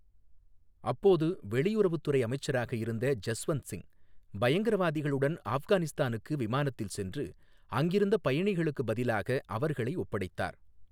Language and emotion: Tamil, neutral